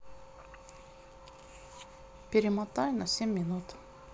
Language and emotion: Russian, neutral